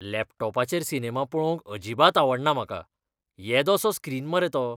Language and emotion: Goan Konkani, disgusted